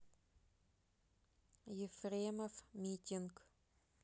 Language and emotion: Russian, neutral